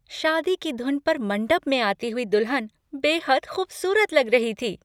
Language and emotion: Hindi, happy